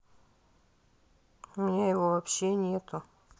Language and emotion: Russian, sad